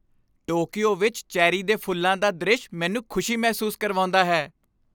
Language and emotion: Punjabi, happy